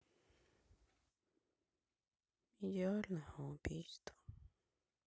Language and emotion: Russian, sad